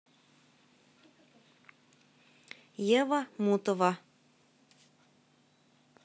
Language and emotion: Russian, neutral